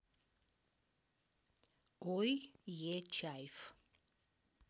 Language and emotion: Russian, neutral